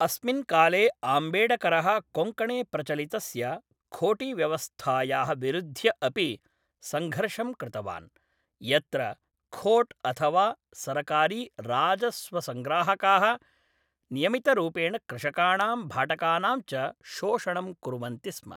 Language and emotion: Sanskrit, neutral